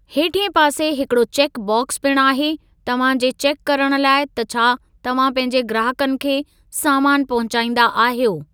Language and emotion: Sindhi, neutral